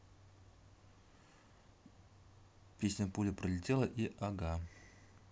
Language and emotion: Russian, neutral